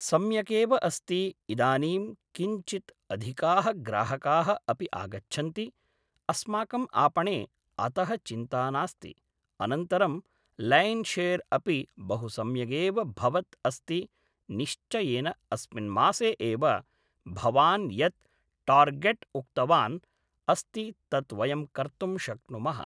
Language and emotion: Sanskrit, neutral